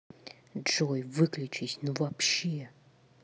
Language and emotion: Russian, angry